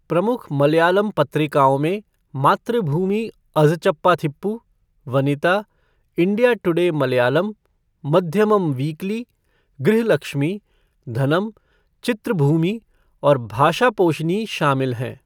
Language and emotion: Hindi, neutral